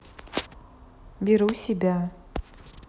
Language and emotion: Russian, neutral